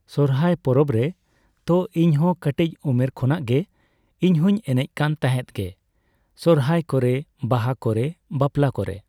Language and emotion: Santali, neutral